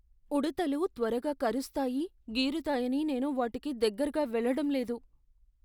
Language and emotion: Telugu, fearful